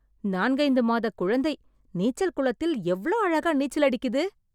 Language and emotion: Tamil, surprised